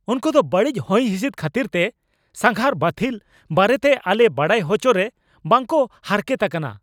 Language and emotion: Santali, angry